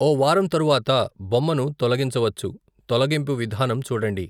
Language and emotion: Telugu, neutral